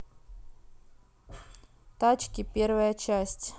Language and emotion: Russian, neutral